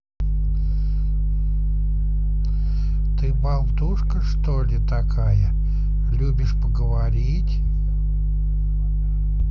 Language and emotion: Russian, neutral